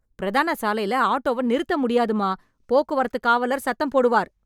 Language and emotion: Tamil, angry